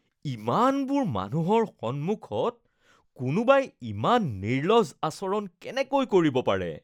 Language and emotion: Assamese, disgusted